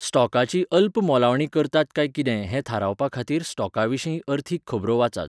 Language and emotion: Goan Konkani, neutral